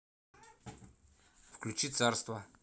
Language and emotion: Russian, neutral